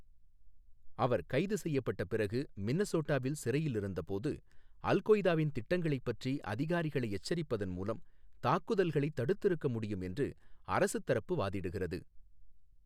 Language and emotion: Tamil, neutral